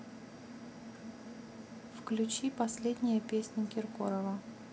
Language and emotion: Russian, neutral